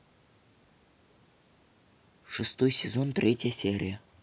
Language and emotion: Russian, neutral